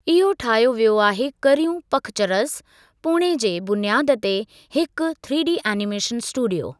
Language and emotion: Sindhi, neutral